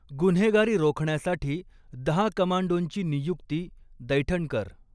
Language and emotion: Marathi, neutral